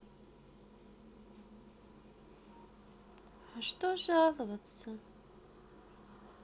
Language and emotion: Russian, sad